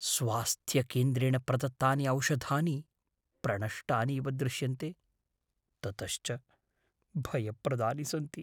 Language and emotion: Sanskrit, fearful